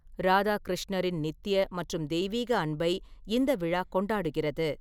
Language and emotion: Tamil, neutral